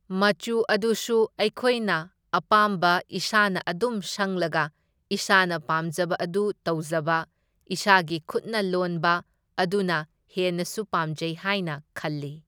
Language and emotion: Manipuri, neutral